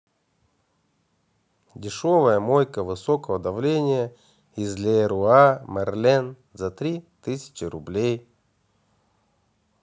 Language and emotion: Russian, neutral